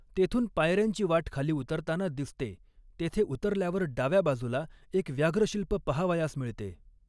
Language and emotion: Marathi, neutral